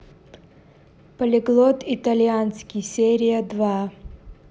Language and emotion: Russian, neutral